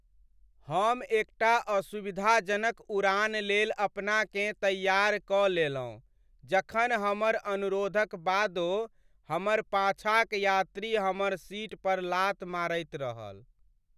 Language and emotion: Maithili, sad